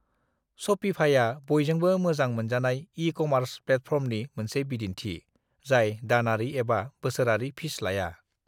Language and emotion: Bodo, neutral